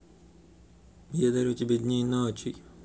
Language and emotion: Russian, neutral